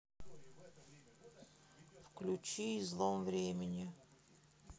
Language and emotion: Russian, sad